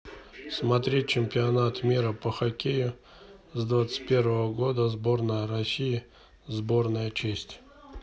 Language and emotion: Russian, neutral